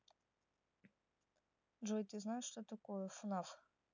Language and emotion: Russian, neutral